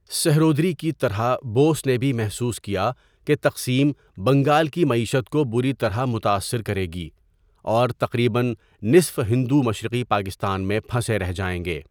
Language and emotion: Urdu, neutral